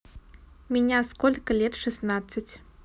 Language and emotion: Russian, neutral